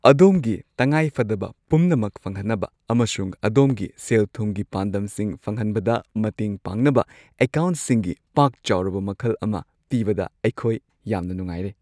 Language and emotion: Manipuri, happy